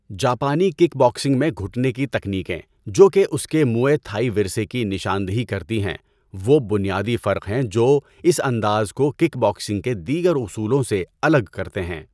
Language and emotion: Urdu, neutral